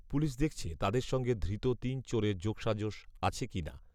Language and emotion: Bengali, neutral